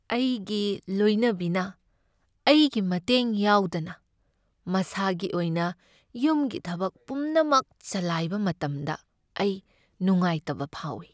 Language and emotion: Manipuri, sad